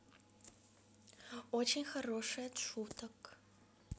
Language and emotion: Russian, positive